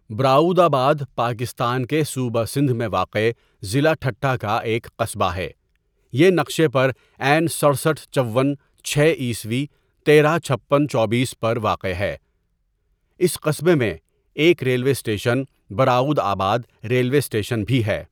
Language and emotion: Urdu, neutral